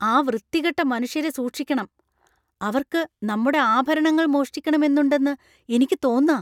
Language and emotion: Malayalam, fearful